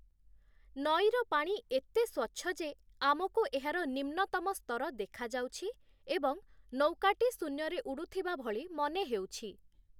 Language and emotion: Odia, neutral